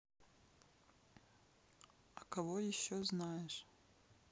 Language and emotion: Russian, neutral